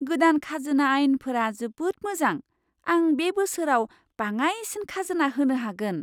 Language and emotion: Bodo, surprised